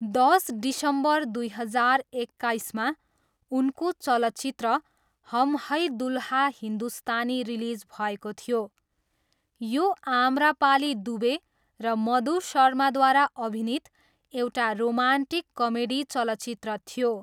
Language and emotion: Nepali, neutral